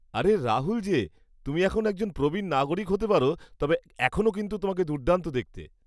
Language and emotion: Bengali, happy